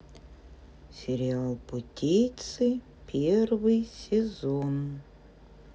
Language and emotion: Russian, neutral